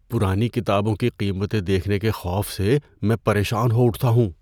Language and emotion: Urdu, fearful